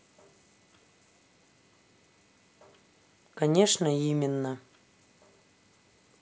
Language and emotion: Russian, neutral